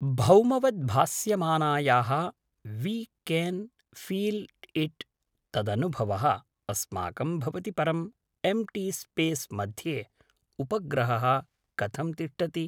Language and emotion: Sanskrit, neutral